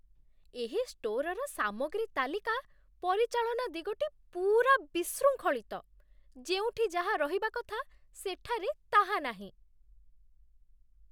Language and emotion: Odia, disgusted